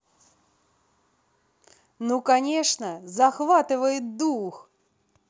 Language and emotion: Russian, positive